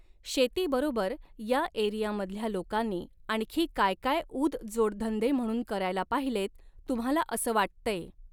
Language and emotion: Marathi, neutral